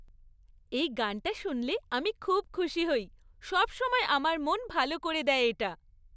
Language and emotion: Bengali, happy